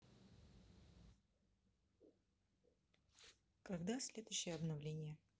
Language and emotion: Russian, neutral